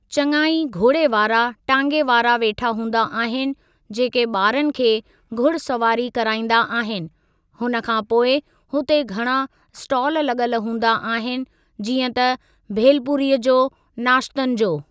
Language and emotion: Sindhi, neutral